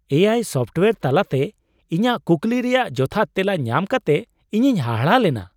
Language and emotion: Santali, surprised